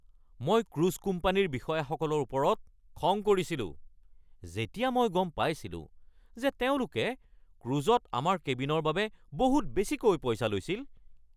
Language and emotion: Assamese, angry